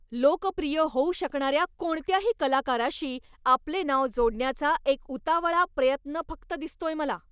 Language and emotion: Marathi, angry